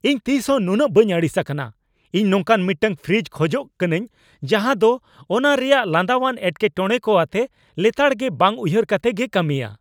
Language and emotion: Santali, angry